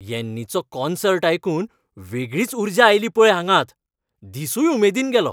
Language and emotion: Goan Konkani, happy